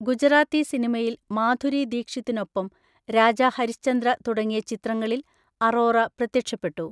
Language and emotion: Malayalam, neutral